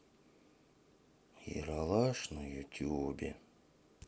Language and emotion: Russian, sad